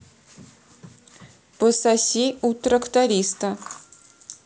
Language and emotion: Russian, neutral